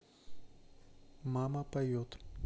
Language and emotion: Russian, neutral